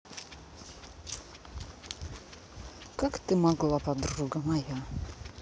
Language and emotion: Russian, angry